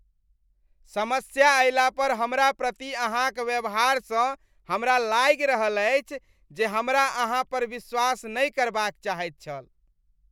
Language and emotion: Maithili, disgusted